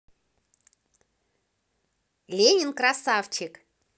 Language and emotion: Russian, positive